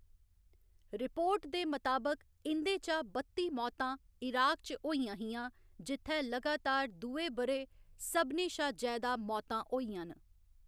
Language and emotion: Dogri, neutral